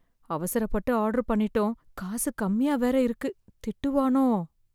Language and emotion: Tamil, fearful